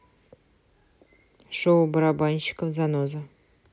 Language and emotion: Russian, neutral